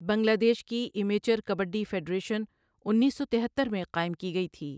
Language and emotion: Urdu, neutral